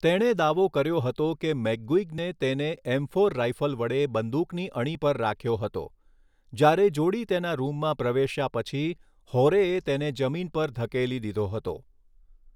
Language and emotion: Gujarati, neutral